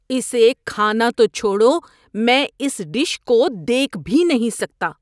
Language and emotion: Urdu, disgusted